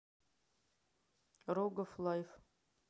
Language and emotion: Russian, neutral